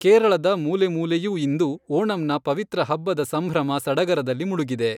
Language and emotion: Kannada, neutral